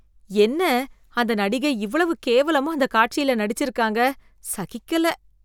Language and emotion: Tamil, disgusted